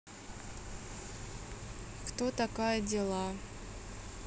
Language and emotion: Russian, neutral